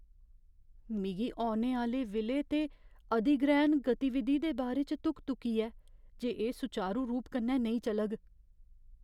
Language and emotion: Dogri, fearful